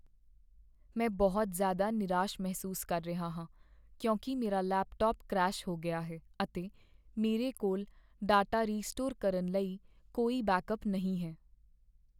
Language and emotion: Punjabi, sad